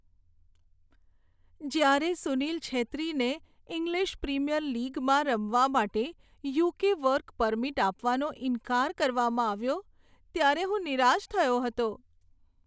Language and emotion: Gujarati, sad